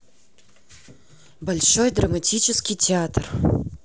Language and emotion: Russian, neutral